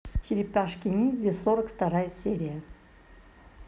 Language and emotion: Russian, positive